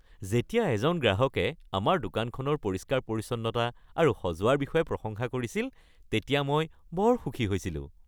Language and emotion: Assamese, happy